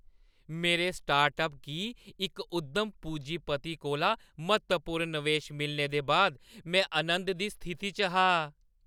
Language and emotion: Dogri, happy